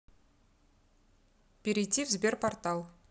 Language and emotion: Russian, neutral